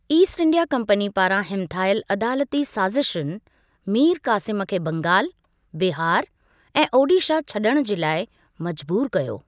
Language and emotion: Sindhi, neutral